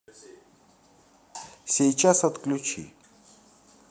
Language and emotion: Russian, neutral